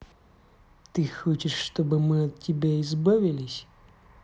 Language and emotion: Russian, angry